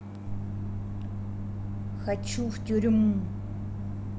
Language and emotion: Russian, angry